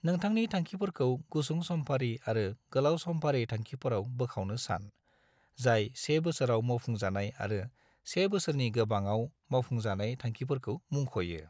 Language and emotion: Bodo, neutral